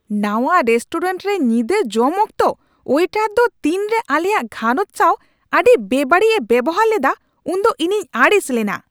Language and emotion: Santali, angry